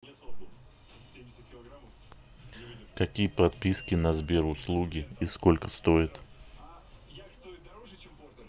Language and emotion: Russian, neutral